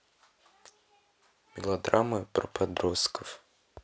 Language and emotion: Russian, neutral